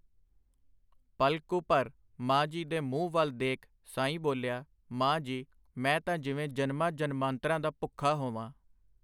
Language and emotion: Punjabi, neutral